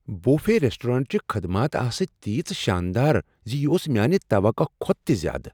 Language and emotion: Kashmiri, surprised